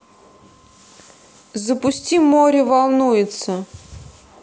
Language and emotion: Russian, neutral